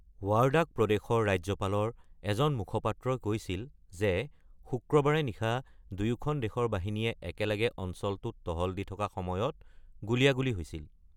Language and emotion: Assamese, neutral